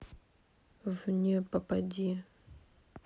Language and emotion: Russian, neutral